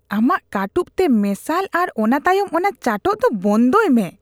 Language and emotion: Santali, disgusted